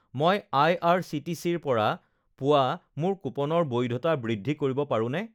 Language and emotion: Assamese, neutral